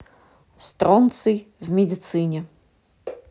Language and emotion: Russian, neutral